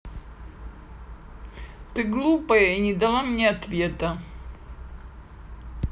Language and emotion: Russian, sad